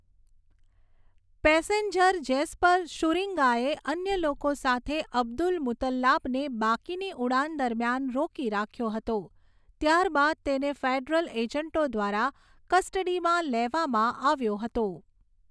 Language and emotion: Gujarati, neutral